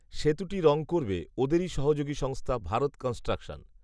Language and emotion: Bengali, neutral